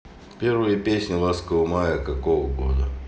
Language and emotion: Russian, neutral